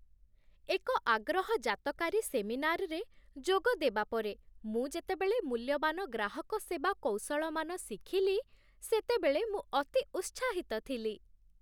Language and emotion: Odia, happy